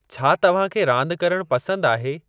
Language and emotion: Sindhi, neutral